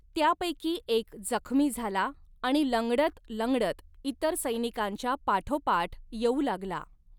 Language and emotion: Marathi, neutral